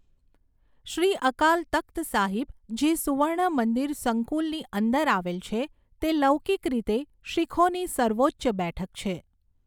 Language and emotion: Gujarati, neutral